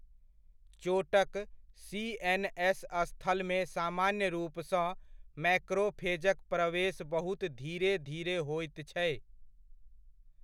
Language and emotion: Maithili, neutral